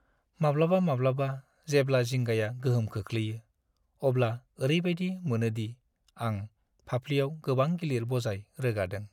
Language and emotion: Bodo, sad